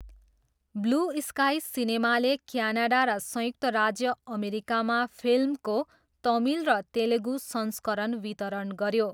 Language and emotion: Nepali, neutral